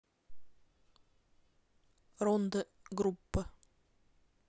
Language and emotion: Russian, neutral